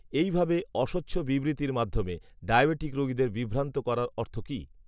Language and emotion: Bengali, neutral